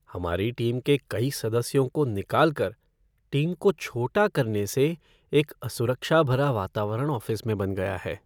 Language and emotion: Hindi, sad